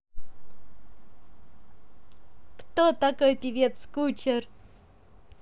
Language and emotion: Russian, positive